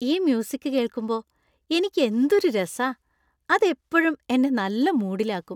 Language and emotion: Malayalam, happy